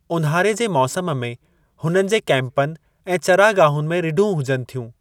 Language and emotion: Sindhi, neutral